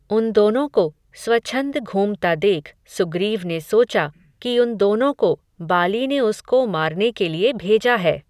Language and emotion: Hindi, neutral